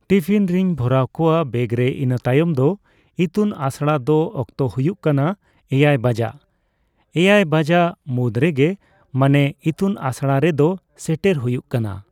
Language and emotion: Santali, neutral